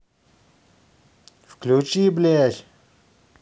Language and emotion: Russian, angry